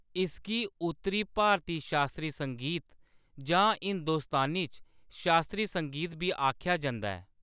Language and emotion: Dogri, neutral